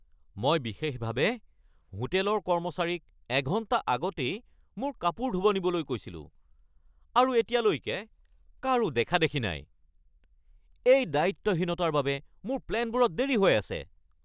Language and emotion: Assamese, angry